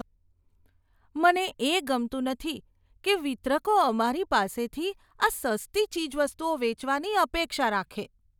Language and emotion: Gujarati, disgusted